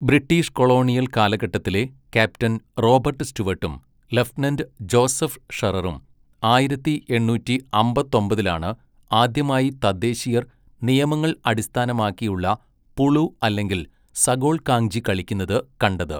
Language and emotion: Malayalam, neutral